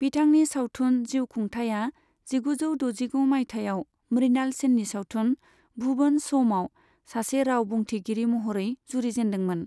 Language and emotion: Bodo, neutral